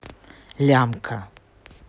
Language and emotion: Russian, neutral